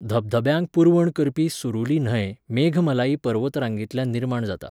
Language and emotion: Goan Konkani, neutral